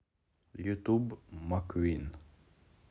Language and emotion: Russian, neutral